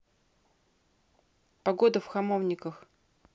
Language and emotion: Russian, neutral